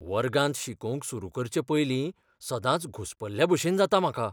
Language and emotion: Goan Konkani, fearful